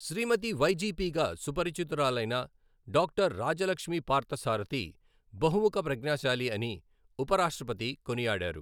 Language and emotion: Telugu, neutral